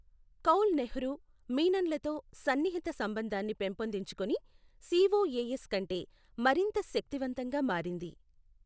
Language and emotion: Telugu, neutral